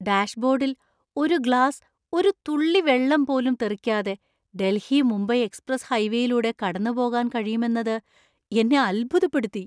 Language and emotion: Malayalam, surprised